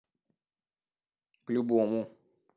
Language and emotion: Russian, neutral